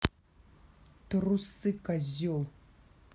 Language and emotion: Russian, angry